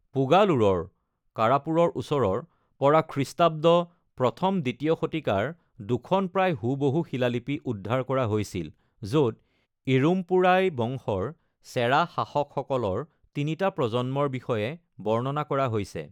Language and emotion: Assamese, neutral